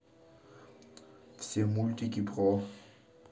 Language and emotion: Russian, neutral